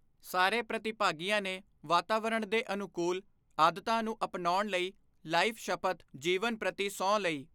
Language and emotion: Punjabi, neutral